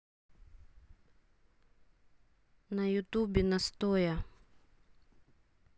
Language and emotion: Russian, neutral